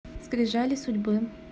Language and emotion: Russian, neutral